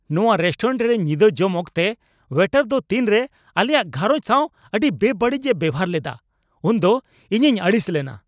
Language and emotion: Santali, angry